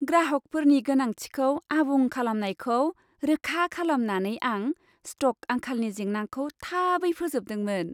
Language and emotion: Bodo, happy